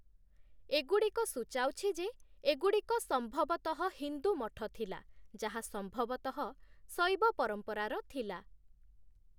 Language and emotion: Odia, neutral